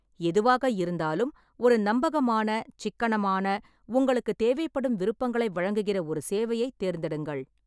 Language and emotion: Tamil, neutral